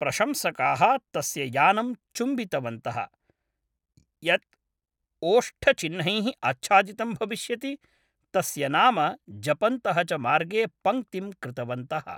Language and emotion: Sanskrit, neutral